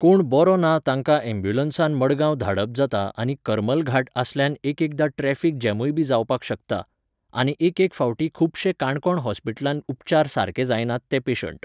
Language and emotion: Goan Konkani, neutral